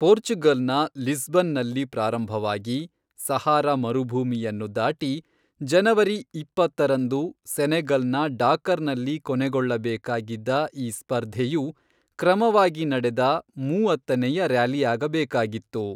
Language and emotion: Kannada, neutral